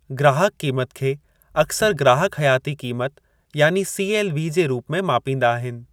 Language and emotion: Sindhi, neutral